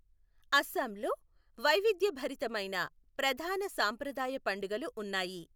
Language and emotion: Telugu, neutral